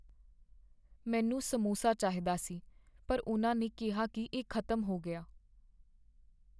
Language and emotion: Punjabi, sad